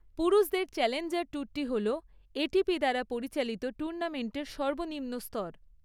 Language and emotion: Bengali, neutral